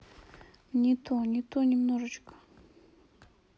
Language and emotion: Russian, sad